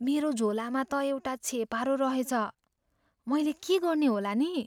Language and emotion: Nepali, fearful